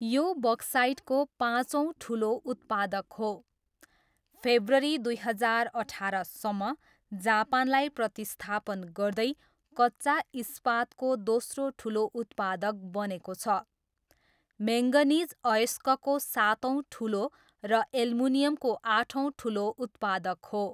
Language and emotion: Nepali, neutral